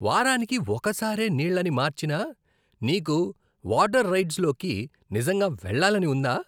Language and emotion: Telugu, disgusted